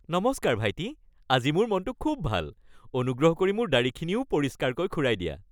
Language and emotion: Assamese, happy